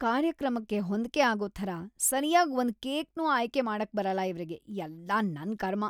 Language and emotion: Kannada, disgusted